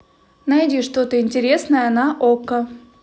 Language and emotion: Russian, neutral